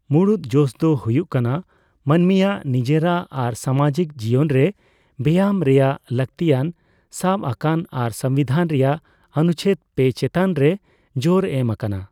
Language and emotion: Santali, neutral